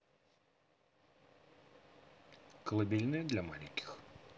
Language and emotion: Russian, neutral